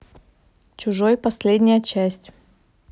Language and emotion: Russian, neutral